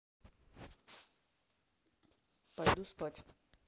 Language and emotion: Russian, neutral